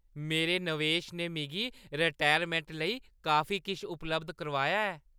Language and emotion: Dogri, happy